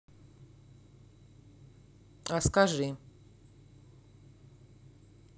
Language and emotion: Russian, neutral